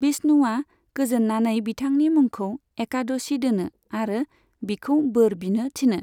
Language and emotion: Bodo, neutral